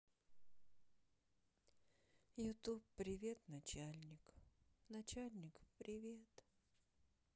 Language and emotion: Russian, sad